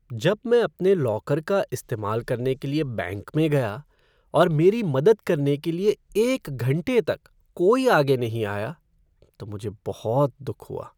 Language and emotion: Hindi, sad